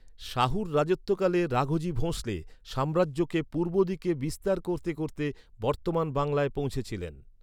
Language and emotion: Bengali, neutral